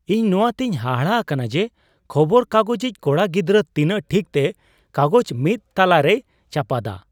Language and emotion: Santali, surprised